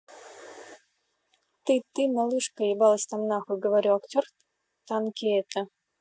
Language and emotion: Russian, neutral